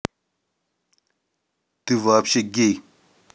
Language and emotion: Russian, angry